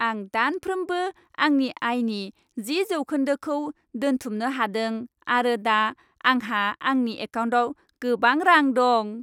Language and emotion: Bodo, happy